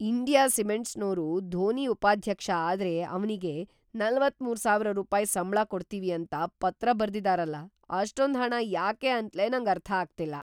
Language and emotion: Kannada, surprised